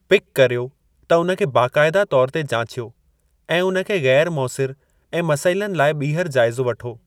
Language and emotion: Sindhi, neutral